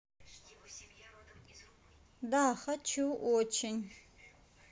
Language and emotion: Russian, neutral